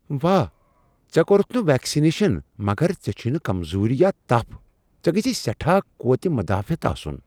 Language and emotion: Kashmiri, surprised